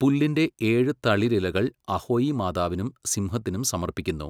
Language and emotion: Malayalam, neutral